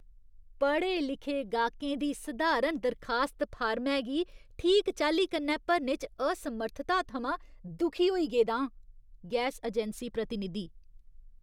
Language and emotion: Dogri, disgusted